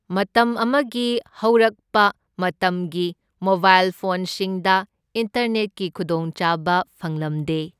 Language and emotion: Manipuri, neutral